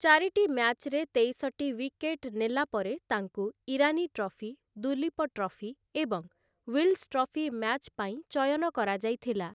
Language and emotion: Odia, neutral